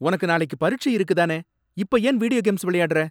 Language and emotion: Tamil, angry